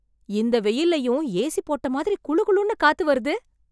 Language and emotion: Tamil, surprised